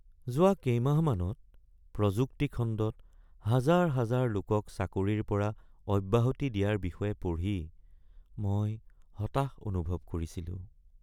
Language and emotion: Assamese, sad